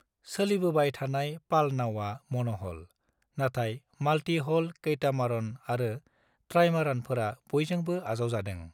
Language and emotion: Bodo, neutral